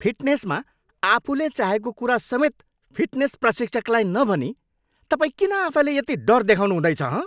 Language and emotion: Nepali, angry